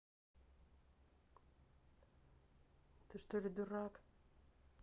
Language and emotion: Russian, neutral